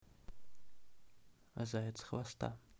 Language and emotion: Russian, neutral